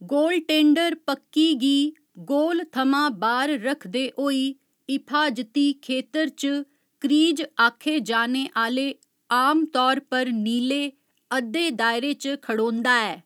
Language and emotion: Dogri, neutral